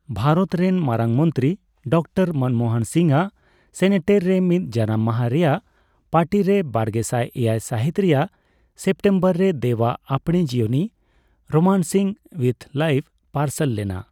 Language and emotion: Santali, neutral